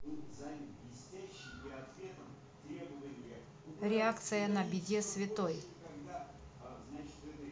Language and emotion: Russian, neutral